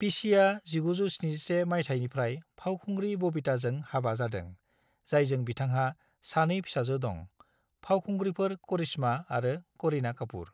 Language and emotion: Bodo, neutral